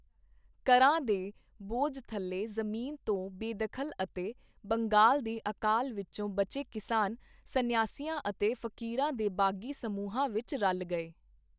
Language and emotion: Punjabi, neutral